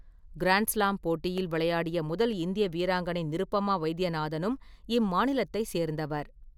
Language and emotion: Tamil, neutral